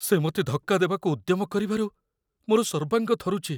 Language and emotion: Odia, fearful